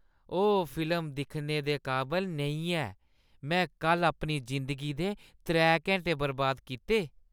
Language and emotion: Dogri, disgusted